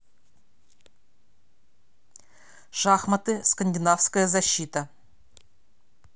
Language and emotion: Russian, neutral